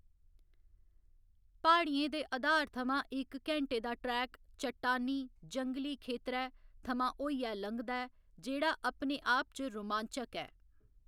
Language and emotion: Dogri, neutral